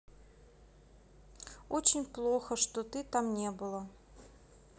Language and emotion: Russian, sad